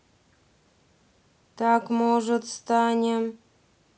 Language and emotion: Russian, neutral